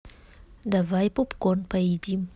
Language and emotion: Russian, neutral